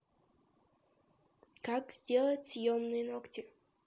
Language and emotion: Russian, neutral